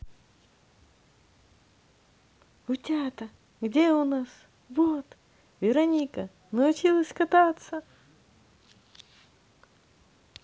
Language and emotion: Russian, positive